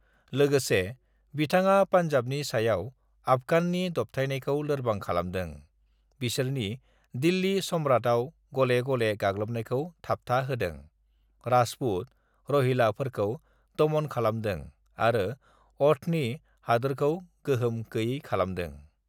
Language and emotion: Bodo, neutral